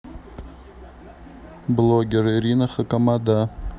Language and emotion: Russian, neutral